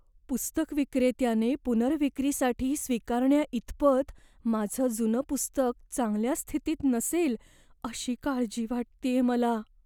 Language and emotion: Marathi, fearful